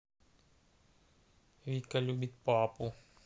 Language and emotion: Russian, neutral